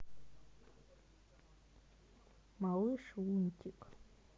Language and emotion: Russian, neutral